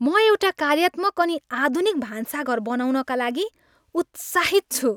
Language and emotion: Nepali, happy